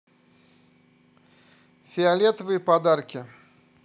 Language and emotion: Russian, neutral